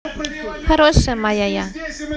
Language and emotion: Russian, positive